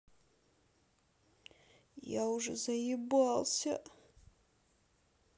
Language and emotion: Russian, sad